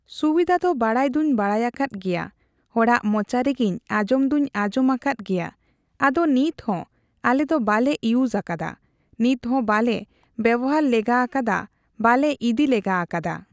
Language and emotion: Santali, neutral